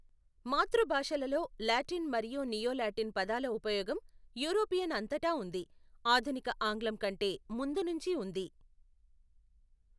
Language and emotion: Telugu, neutral